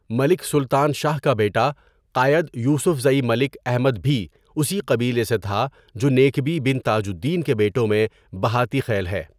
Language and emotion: Urdu, neutral